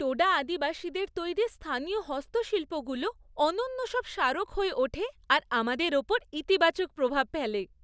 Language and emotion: Bengali, happy